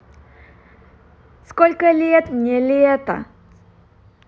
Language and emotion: Russian, positive